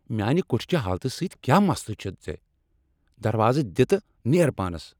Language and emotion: Kashmiri, angry